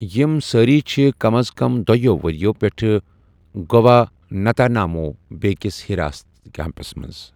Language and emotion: Kashmiri, neutral